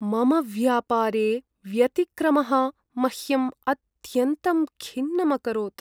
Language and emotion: Sanskrit, sad